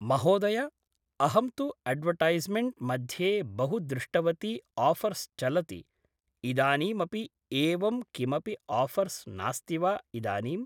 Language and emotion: Sanskrit, neutral